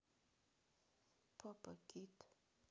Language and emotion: Russian, neutral